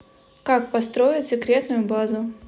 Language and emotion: Russian, neutral